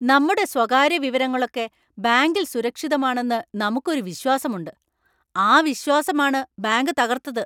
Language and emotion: Malayalam, angry